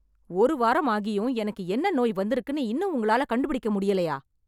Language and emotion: Tamil, angry